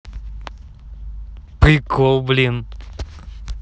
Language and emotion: Russian, positive